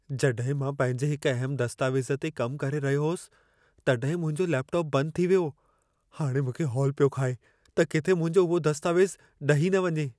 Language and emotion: Sindhi, fearful